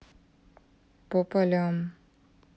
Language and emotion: Russian, neutral